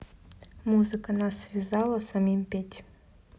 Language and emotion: Russian, neutral